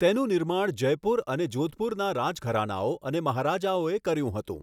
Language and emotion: Gujarati, neutral